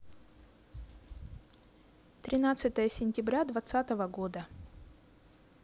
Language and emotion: Russian, neutral